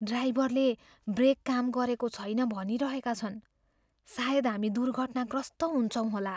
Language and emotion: Nepali, fearful